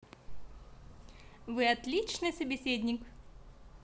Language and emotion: Russian, positive